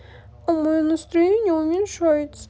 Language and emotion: Russian, sad